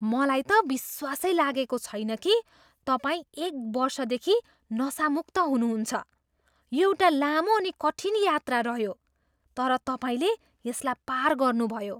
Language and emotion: Nepali, surprised